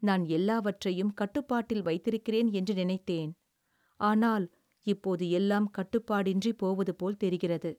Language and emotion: Tamil, sad